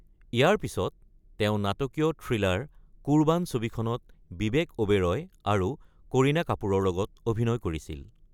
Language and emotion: Assamese, neutral